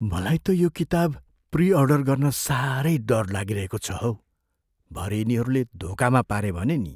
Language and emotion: Nepali, fearful